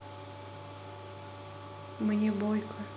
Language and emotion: Russian, sad